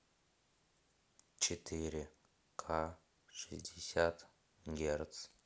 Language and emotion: Russian, neutral